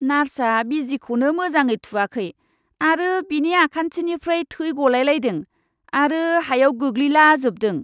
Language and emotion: Bodo, disgusted